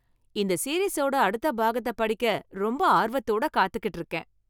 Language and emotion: Tamil, happy